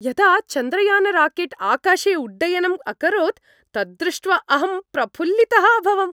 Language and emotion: Sanskrit, happy